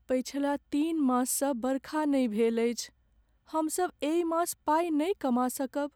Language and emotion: Maithili, sad